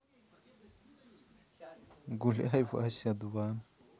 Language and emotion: Russian, positive